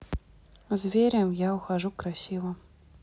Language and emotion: Russian, neutral